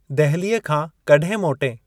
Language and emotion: Sindhi, neutral